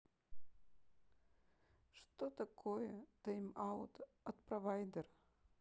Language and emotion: Russian, sad